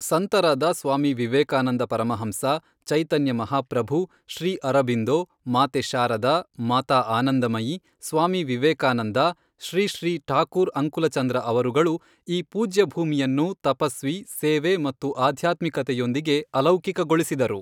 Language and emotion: Kannada, neutral